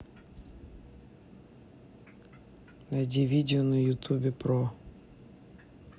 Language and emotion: Russian, neutral